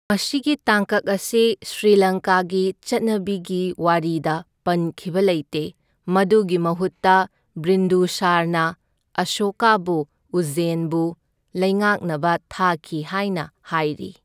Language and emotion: Manipuri, neutral